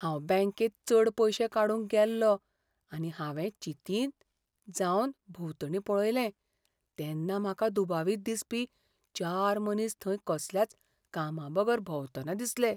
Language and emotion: Goan Konkani, fearful